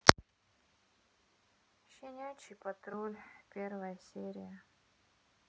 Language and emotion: Russian, sad